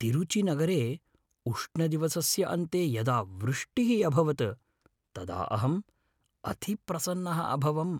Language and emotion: Sanskrit, happy